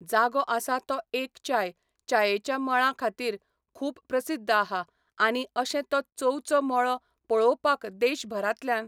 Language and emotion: Goan Konkani, neutral